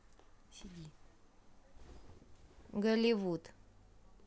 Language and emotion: Russian, neutral